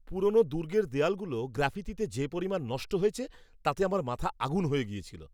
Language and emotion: Bengali, angry